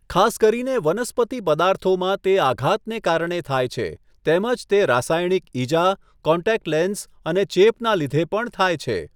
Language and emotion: Gujarati, neutral